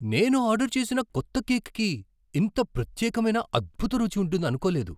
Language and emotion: Telugu, surprised